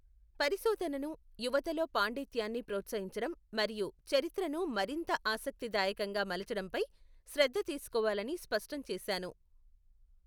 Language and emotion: Telugu, neutral